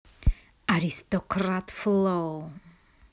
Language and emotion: Russian, angry